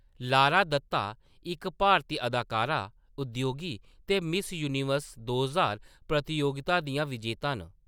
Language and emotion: Dogri, neutral